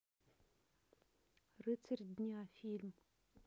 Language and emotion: Russian, neutral